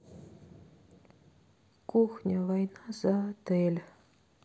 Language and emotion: Russian, sad